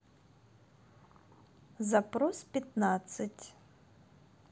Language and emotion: Russian, neutral